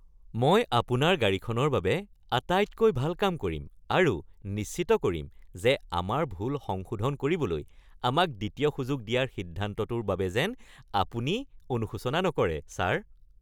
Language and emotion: Assamese, happy